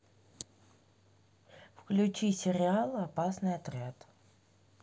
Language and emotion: Russian, neutral